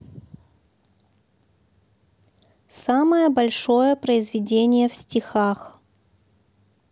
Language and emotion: Russian, neutral